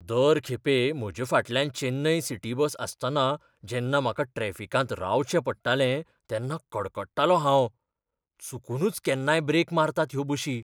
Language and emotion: Goan Konkani, fearful